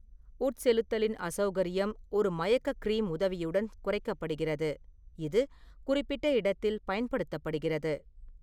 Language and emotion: Tamil, neutral